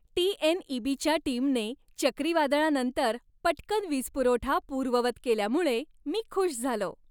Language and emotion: Marathi, happy